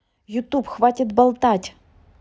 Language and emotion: Russian, angry